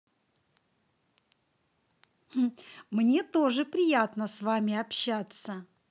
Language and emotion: Russian, positive